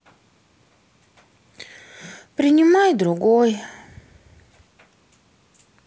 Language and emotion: Russian, sad